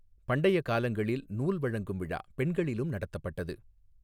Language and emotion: Tamil, neutral